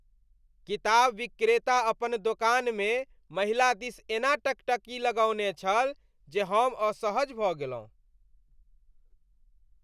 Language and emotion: Maithili, disgusted